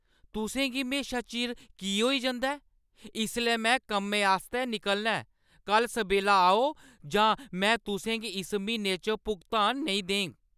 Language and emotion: Dogri, angry